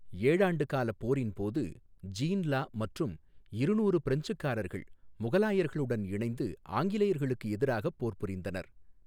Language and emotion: Tamil, neutral